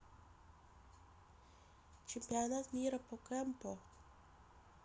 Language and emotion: Russian, neutral